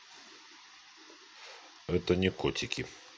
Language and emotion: Russian, neutral